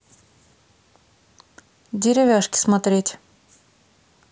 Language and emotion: Russian, neutral